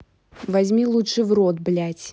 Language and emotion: Russian, angry